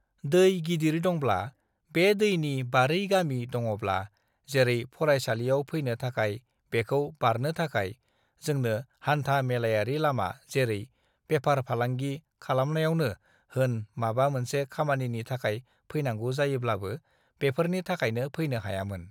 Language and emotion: Bodo, neutral